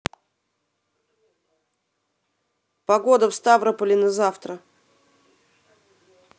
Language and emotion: Russian, neutral